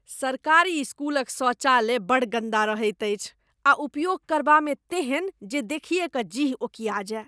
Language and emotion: Maithili, disgusted